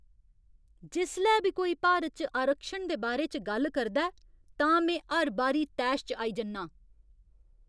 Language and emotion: Dogri, angry